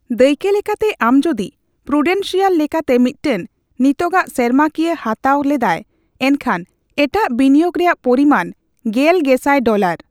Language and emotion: Santali, neutral